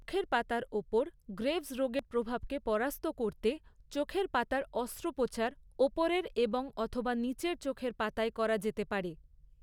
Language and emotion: Bengali, neutral